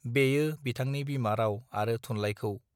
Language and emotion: Bodo, neutral